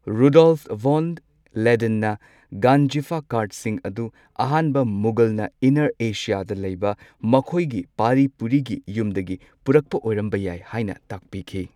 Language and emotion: Manipuri, neutral